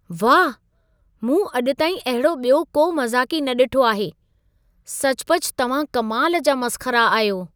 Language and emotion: Sindhi, surprised